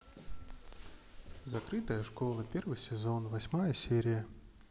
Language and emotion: Russian, neutral